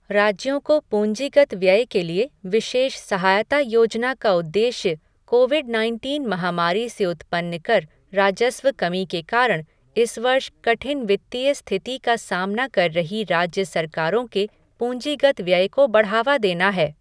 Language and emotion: Hindi, neutral